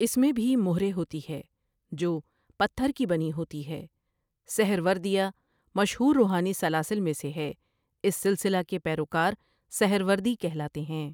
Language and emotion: Urdu, neutral